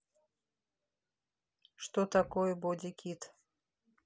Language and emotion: Russian, neutral